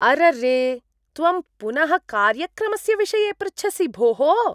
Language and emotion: Sanskrit, disgusted